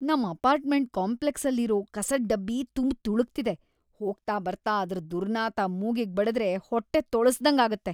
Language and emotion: Kannada, disgusted